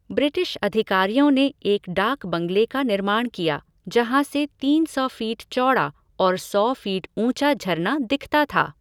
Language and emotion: Hindi, neutral